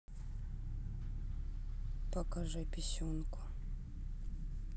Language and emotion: Russian, sad